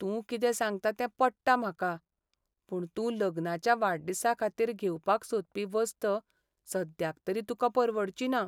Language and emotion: Goan Konkani, sad